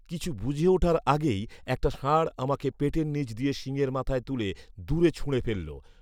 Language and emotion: Bengali, neutral